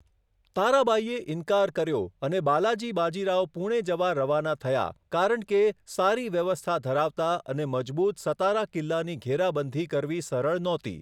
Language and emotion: Gujarati, neutral